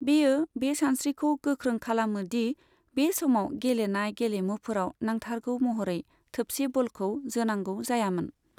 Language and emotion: Bodo, neutral